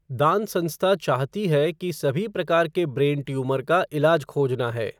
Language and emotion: Hindi, neutral